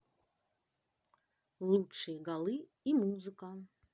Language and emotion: Russian, positive